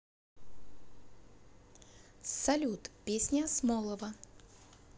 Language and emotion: Russian, neutral